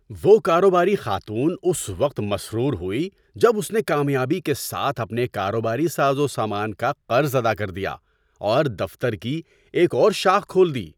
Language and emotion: Urdu, happy